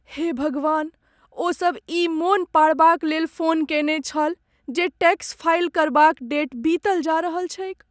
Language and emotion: Maithili, sad